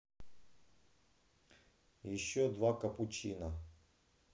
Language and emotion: Russian, neutral